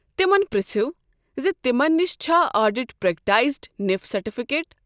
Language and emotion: Kashmiri, neutral